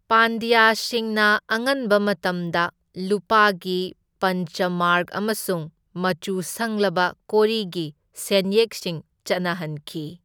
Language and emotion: Manipuri, neutral